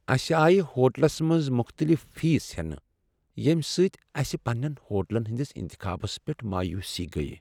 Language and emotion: Kashmiri, sad